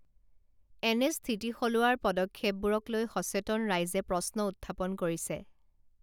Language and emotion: Assamese, neutral